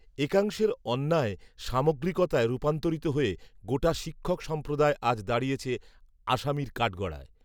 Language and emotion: Bengali, neutral